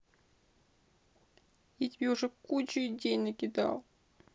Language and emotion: Russian, sad